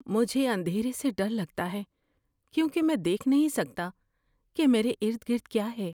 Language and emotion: Urdu, fearful